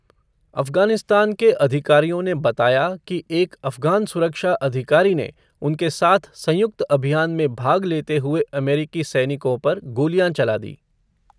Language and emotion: Hindi, neutral